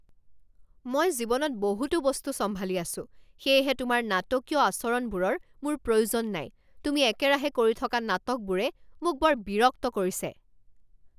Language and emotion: Assamese, angry